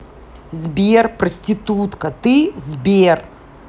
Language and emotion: Russian, angry